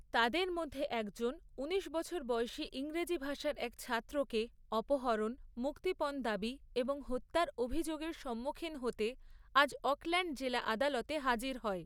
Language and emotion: Bengali, neutral